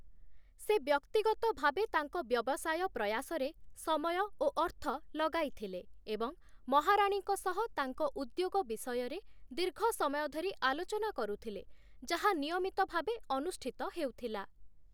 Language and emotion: Odia, neutral